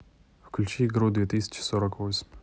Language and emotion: Russian, neutral